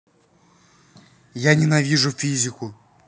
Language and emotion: Russian, angry